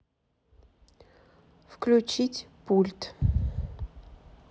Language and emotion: Russian, neutral